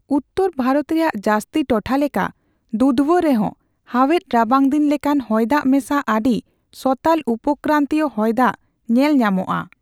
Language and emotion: Santali, neutral